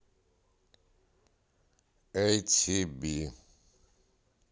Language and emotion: Russian, neutral